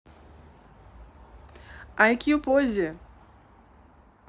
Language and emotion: Russian, neutral